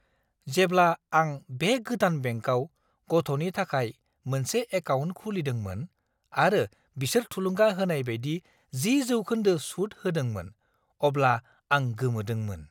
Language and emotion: Bodo, surprised